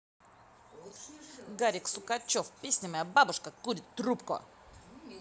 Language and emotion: Russian, positive